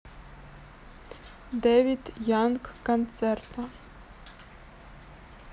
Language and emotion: Russian, neutral